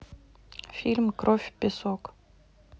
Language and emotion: Russian, neutral